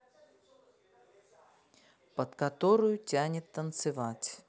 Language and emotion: Russian, neutral